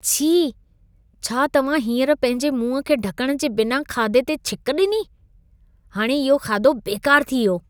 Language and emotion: Sindhi, disgusted